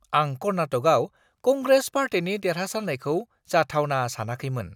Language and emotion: Bodo, surprised